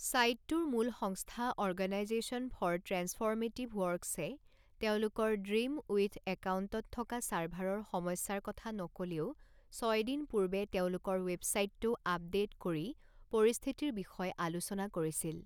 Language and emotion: Assamese, neutral